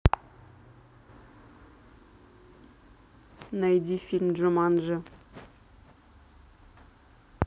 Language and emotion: Russian, neutral